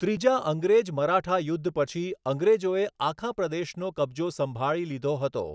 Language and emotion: Gujarati, neutral